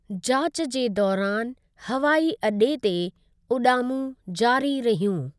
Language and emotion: Sindhi, neutral